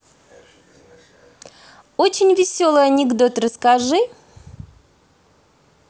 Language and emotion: Russian, positive